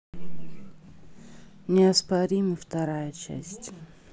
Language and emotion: Russian, neutral